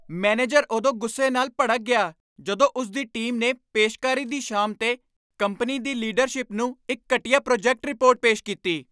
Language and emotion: Punjabi, angry